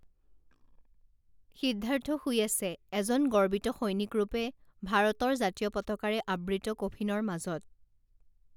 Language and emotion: Assamese, neutral